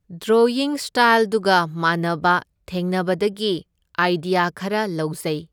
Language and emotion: Manipuri, neutral